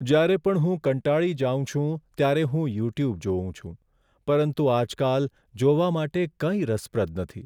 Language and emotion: Gujarati, sad